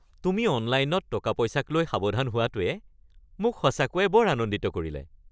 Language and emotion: Assamese, happy